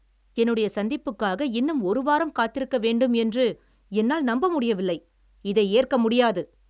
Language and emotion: Tamil, angry